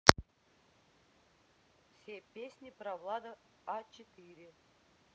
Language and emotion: Russian, neutral